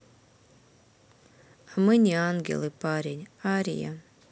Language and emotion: Russian, sad